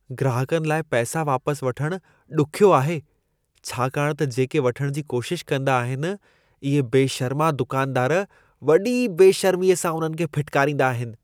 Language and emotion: Sindhi, disgusted